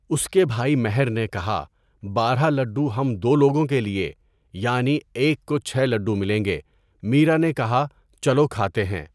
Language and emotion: Urdu, neutral